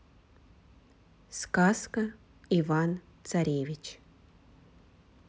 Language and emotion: Russian, neutral